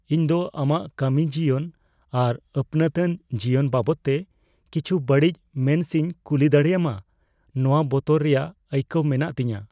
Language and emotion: Santali, fearful